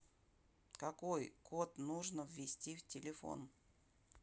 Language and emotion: Russian, neutral